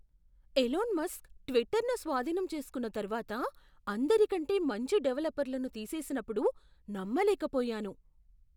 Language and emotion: Telugu, surprised